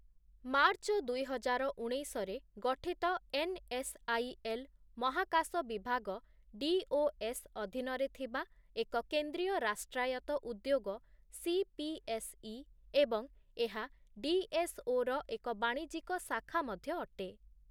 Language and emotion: Odia, neutral